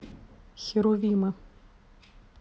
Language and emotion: Russian, neutral